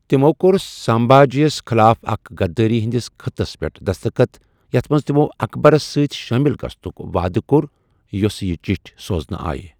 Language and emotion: Kashmiri, neutral